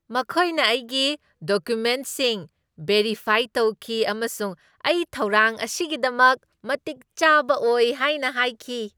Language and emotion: Manipuri, happy